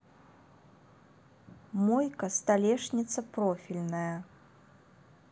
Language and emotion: Russian, neutral